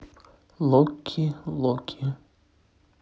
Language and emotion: Russian, neutral